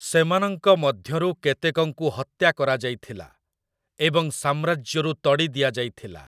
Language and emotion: Odia, neutral